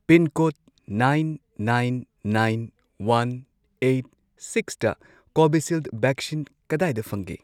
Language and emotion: Manipuri, neutral